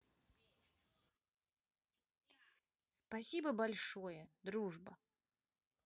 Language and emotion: Russian, positive